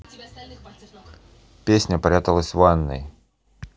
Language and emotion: Russian, neutral